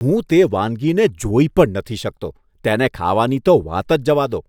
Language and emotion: Gujarati, disgusted